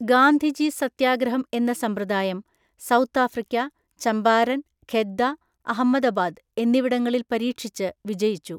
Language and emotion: Malayalam, neutral